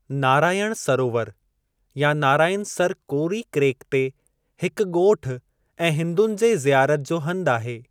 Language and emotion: Sindhi, neutral